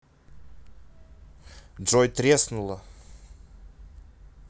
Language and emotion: Russian, neutral